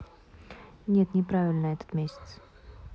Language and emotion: Russian, neutral